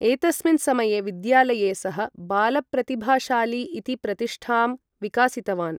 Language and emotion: Sanskrit, neutral